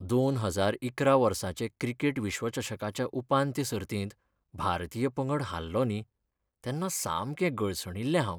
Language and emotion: Goan Konkani, sad